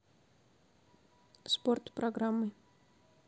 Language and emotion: Russian, neutral